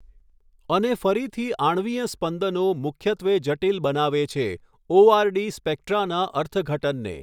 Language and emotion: Gujarati, neutral